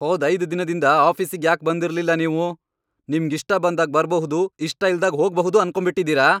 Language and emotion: Kannada, angry